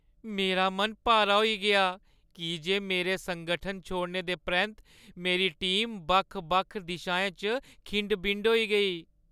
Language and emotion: Dogri, sad